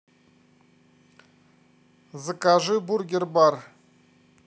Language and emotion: Russian, neutral